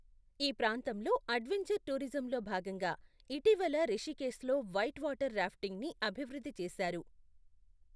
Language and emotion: Telugu, neutral